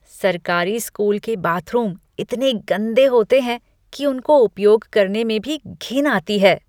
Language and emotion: Hindi, disgusted